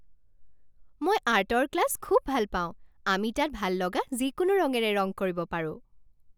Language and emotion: Assamese, happy